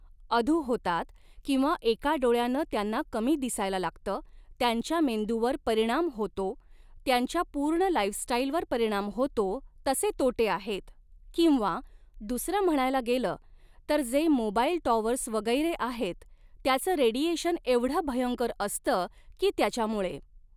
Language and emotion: Marathi, neutral